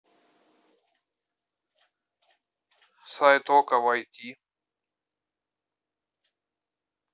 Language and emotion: Russian, neutral